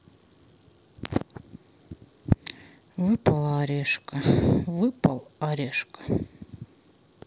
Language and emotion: Russian, sad